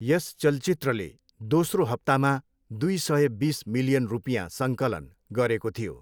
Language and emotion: Nepali, neutral